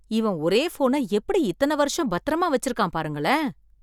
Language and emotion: Tamil, surprised